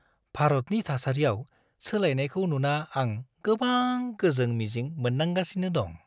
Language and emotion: Bodo, happy